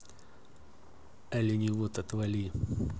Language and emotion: Russian, neutral